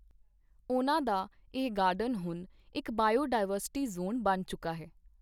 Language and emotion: Punjabi, neutral